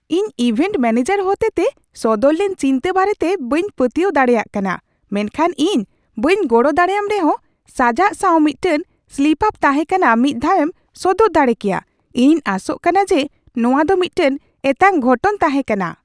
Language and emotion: Santali, surprised